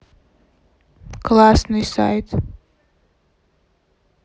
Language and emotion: Russian, neutral